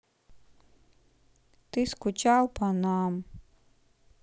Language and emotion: Russian, sad